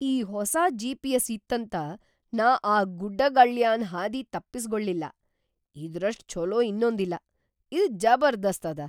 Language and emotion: Kannada, surprised